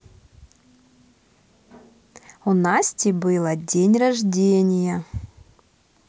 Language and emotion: Russian, positive